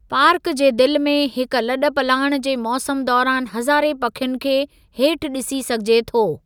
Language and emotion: Sindhi, neutral